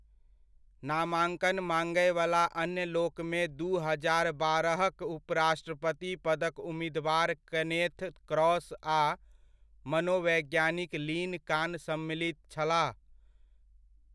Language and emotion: Maithili, neutral